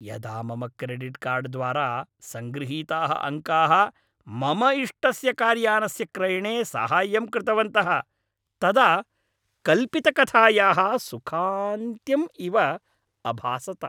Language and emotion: Sanskrit, happy